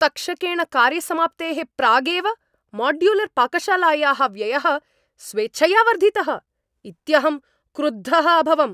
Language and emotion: Sanskrit, angry